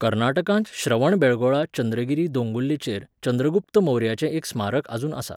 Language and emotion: Goan Konkani, neutral